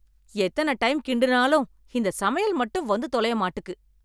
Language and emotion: Tamil, angry